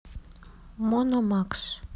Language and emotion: Russian, sad